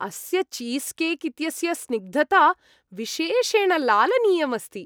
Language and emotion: Sanskrit, happy